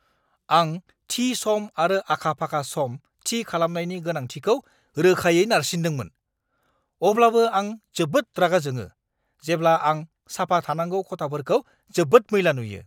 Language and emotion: Bodo, angry